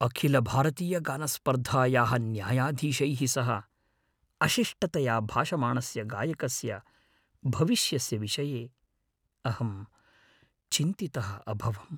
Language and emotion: Sanskrit, fearful